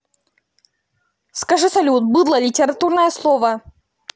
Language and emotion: Russian, angry